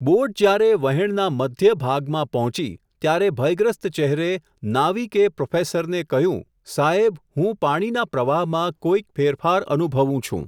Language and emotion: Gujarati, neutral